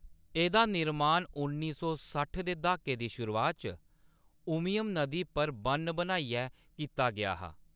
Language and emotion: Dogri, neutral